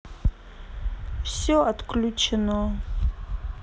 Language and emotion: Russian, sad